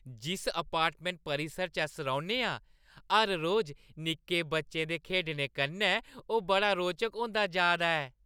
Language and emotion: Dogri, happy